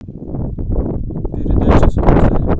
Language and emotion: Russian, neutral